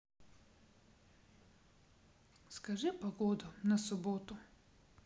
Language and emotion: Russian, sad